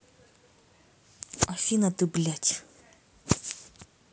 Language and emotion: Russian, angry